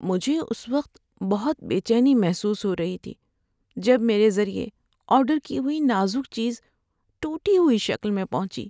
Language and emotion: Urdu, sad